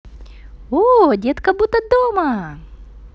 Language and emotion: Russian, positive